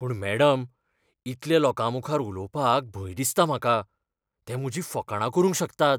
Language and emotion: Goan Konkani, fearful